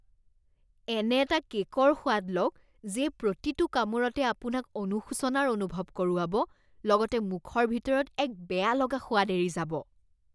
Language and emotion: Assamese, disgusted